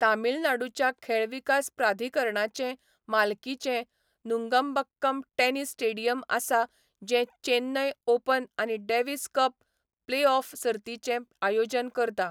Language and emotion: Goan Konkani, neutral